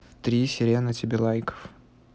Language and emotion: Russian, neutral